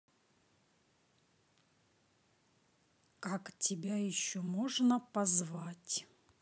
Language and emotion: Russian, neutral